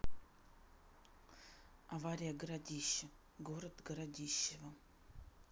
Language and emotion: Russian, neutral